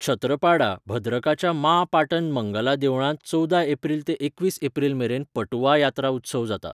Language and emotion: Goan Konkani, neutral